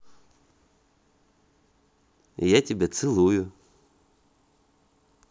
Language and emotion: Russian, positive